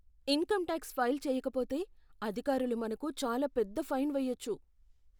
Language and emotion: Telugu, fearful